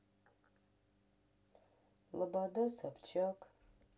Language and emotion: Russian, sad